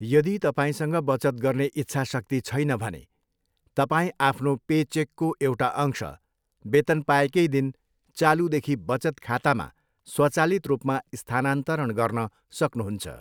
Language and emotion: Nepali, neutral